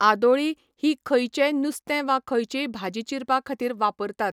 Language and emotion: Goan Konkani, neutral